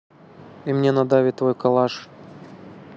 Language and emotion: Russian, neutral